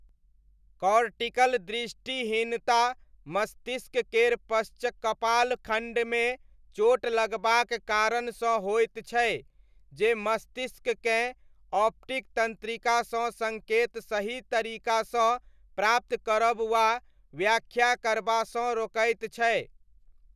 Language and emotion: Maithili, neutral